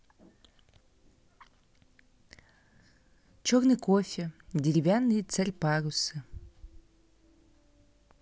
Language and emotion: Russian, neutral